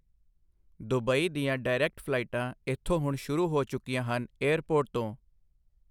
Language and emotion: Punjabi, neutral